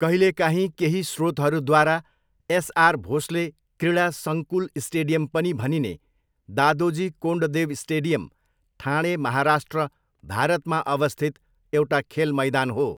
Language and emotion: Nepali, neutral